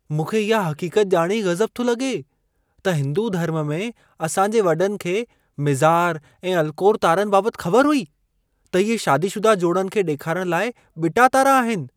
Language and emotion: Sindhi, surprised